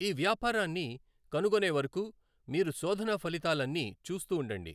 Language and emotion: Telugu, neutral